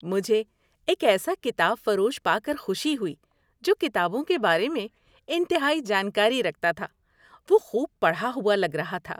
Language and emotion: Urdu, happy